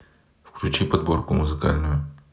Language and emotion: Russian, neutral